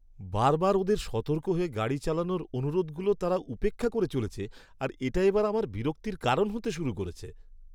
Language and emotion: Bengali, angry